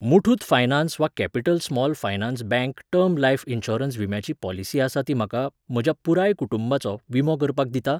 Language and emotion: Goan Konkani, neutral